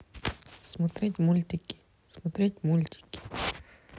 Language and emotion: Russian, neutral